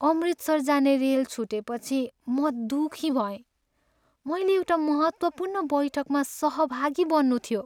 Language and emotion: Nepali, sad